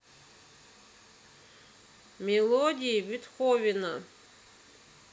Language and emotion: Russian, neutral